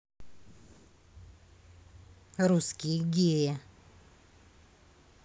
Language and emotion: Russian, neutral